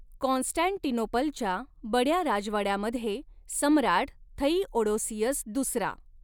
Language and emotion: Marathi, neutral